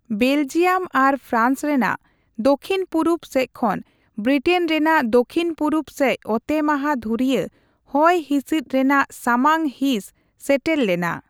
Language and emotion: Santali, neutral